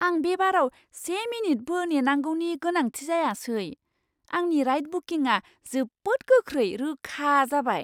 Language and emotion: Bodo, surprised